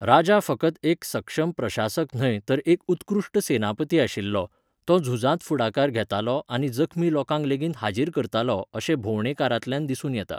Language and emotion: Goan Konkani, neutral